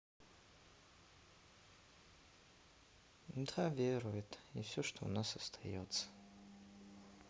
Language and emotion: Russian, sad